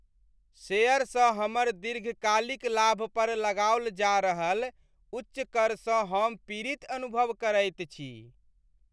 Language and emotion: Maithili, sad